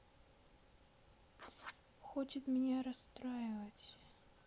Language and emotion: Russian, sad